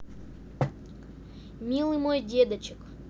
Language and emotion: Russian, neutral